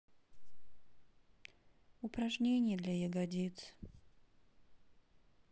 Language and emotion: Russian, sad